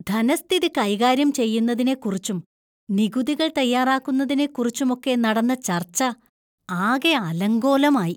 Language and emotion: Malayalam, disgusted